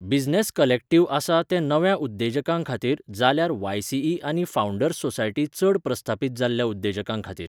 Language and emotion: Goan Konkani, neutral